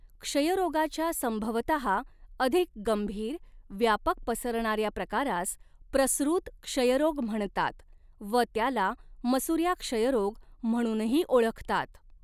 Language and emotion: Marathi, neutral